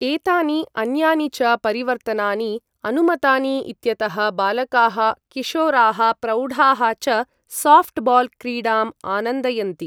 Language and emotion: Sanskrit, neutral